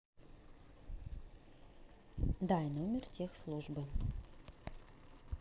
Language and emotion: Russian, neutral